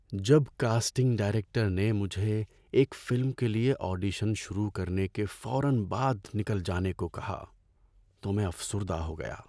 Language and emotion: Urdu, sad